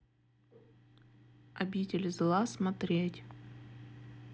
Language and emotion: Russian, neutral